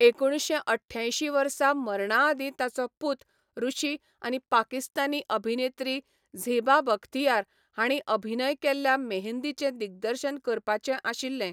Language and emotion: Goan Konkani, neutral